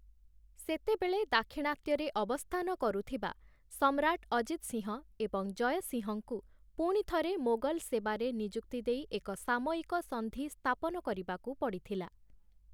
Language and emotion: Odia, neutral